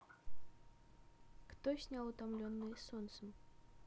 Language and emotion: Russian, neutral